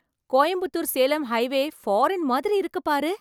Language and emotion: Tamil, surprised